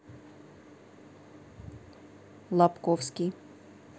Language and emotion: Russian, neutral